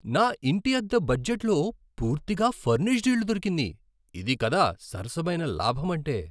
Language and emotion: Telugu, surprised